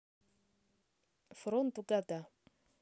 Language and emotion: Russian, neutral